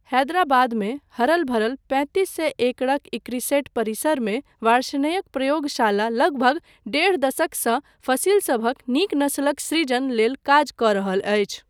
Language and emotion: Maithili, neutral